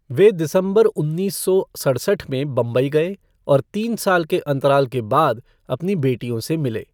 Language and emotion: Hindi, neutral